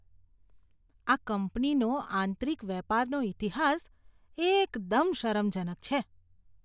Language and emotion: Gujarati, disgusted